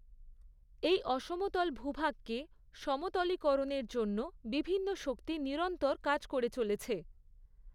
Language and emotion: Bengali, neutral